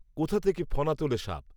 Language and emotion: Bengali, neutral